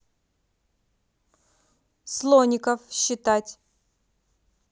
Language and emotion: Russian, positive